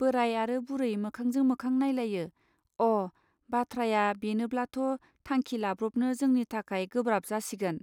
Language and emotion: Bodo, neutral